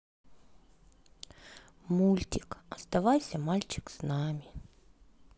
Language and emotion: Russian, sad